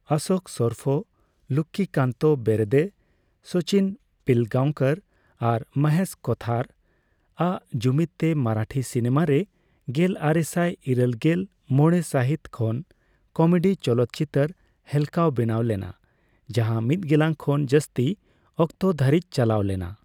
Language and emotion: Santali, neutral